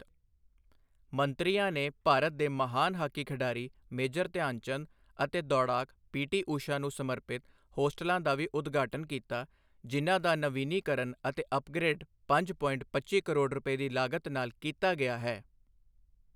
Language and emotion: Punjabi, neutral